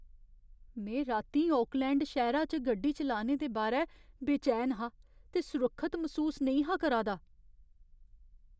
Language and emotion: Dogri, fearful